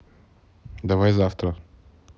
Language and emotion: Russian, neutral